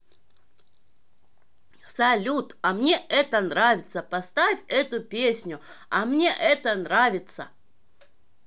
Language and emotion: Russian, positive